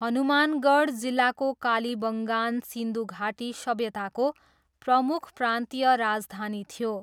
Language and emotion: Nepali, neutral